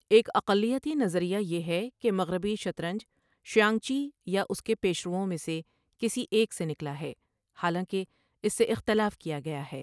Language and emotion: Urdu, neutral